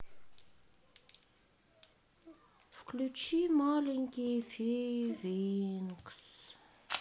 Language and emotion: Russian, sad